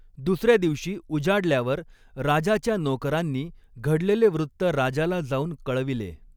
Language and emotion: Marathi, neutral